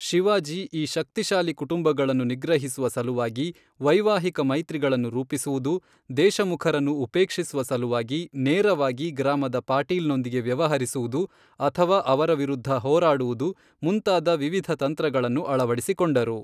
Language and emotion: Kannada, neutral